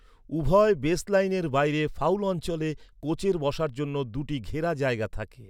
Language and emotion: Bengali, neutral